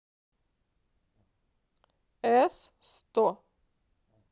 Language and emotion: Russian, neutral